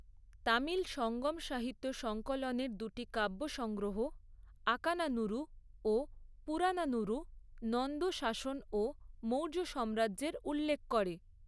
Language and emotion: Bengali, neutral